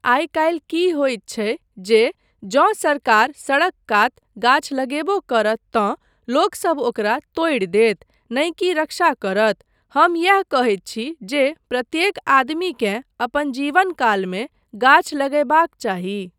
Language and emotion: Maithili, neutral